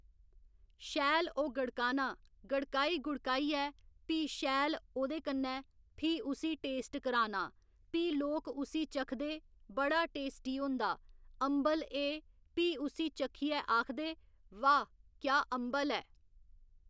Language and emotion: Dogri, neutral